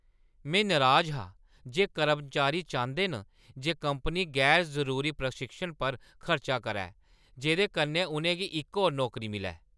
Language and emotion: Dogri, angry